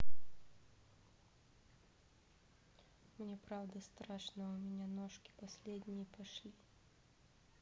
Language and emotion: Russian, neutral